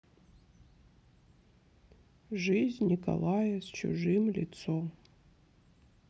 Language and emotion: Russian, sad